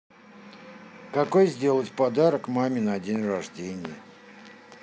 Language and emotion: Russian, neutral